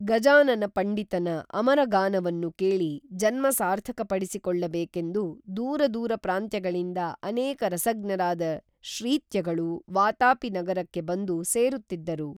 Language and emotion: Kannada, neutral